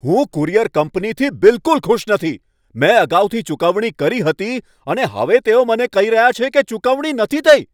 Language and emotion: Gujarati, angry